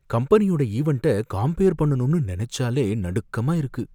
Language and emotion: Tamil, fearful